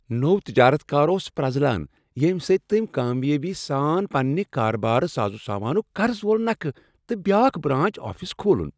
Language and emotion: Kashmiri, happy